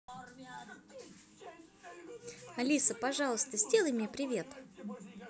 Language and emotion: Russian, positive